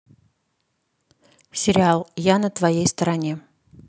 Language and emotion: Russian, neutral